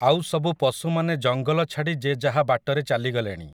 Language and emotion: Odia, neutral